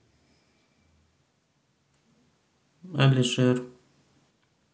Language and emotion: Russian, neutral